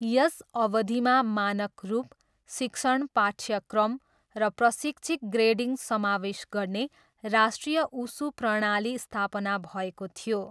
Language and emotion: Nepali, neutral